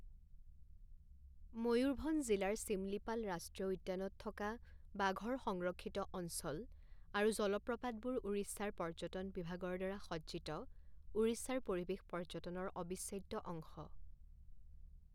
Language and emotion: Assamese, neutral